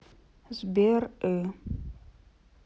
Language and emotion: Russian, sad